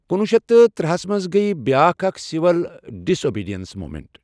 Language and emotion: Kashmiri, neutral